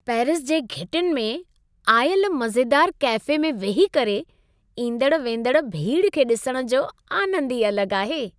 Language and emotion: Sindhi, happy